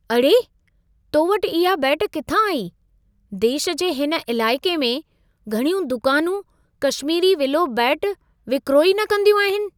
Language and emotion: Sindhi, surprised